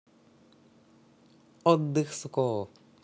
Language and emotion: Russian, neutral